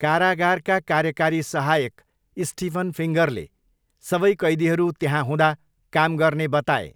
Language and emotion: Nepali, neutral